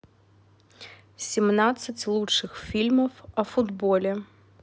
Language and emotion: Russian, neutral